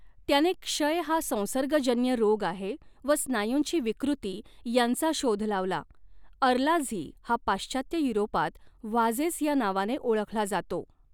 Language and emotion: Marathi, neutral